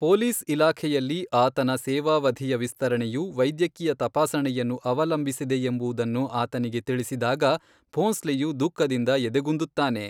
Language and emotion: Kannada, neutral